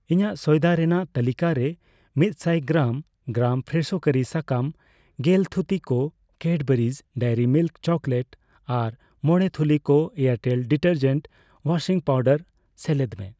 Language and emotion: Santali, neutral